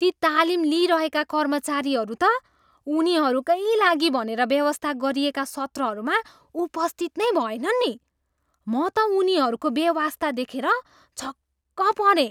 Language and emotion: Nepali, surprised